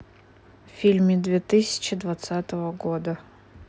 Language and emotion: Russian, neutral